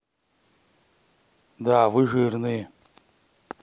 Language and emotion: Russian, neutral